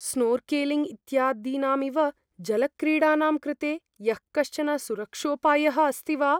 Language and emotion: Sanskrit, fearful